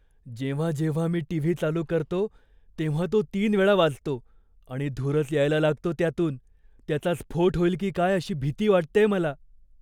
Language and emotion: Marathi, fearful